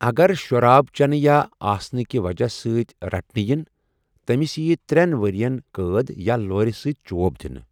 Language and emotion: Kashmiri, neutral